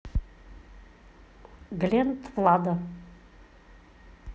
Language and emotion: Russian, neutral